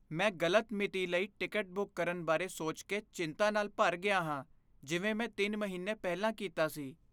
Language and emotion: Punjabi, fearful